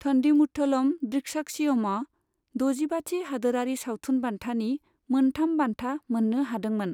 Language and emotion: Bodo, neutral